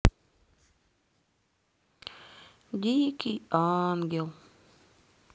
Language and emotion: Russian, sad